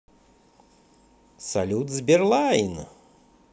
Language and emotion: Russian, positive